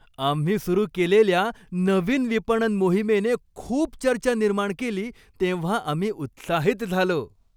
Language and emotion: Marathi, happy